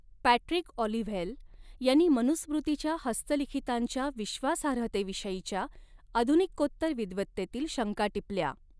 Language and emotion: Marathi, neutral